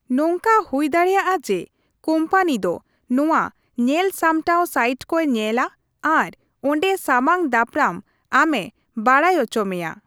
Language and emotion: Santali, neutral